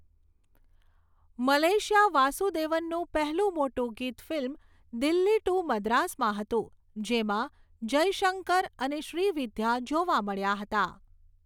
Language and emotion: Gujarati, neutral